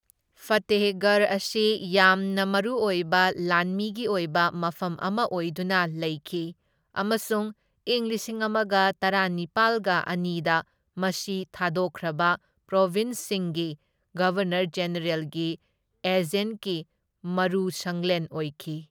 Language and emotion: Manipuri, neutral